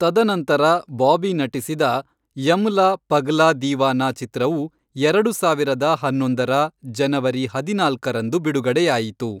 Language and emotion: Kannada, neutral